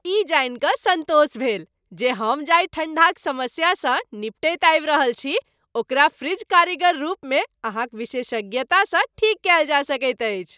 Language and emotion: Maithili, happy